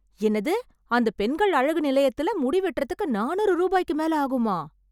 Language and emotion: Tamil, surprised